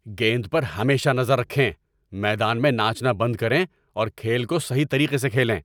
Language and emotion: Urdu, angry